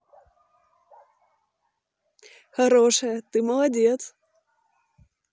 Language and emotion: Russian, positive